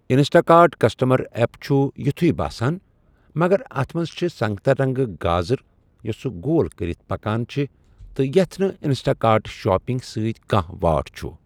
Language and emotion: Kashmiri, neutral